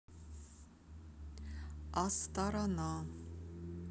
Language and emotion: Russian, neutral